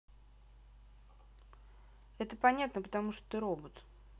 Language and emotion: Russian, neutral